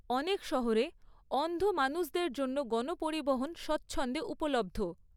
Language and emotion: Bengali, neutral